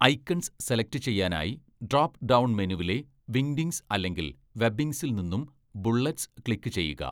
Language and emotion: Malayalam, neutral